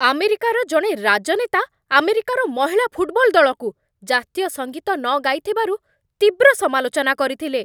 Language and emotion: Odia, angry